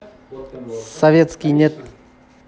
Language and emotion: Russian, neutral